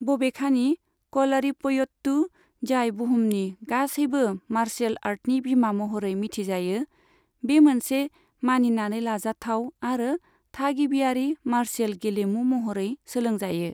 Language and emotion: Bodo, neutral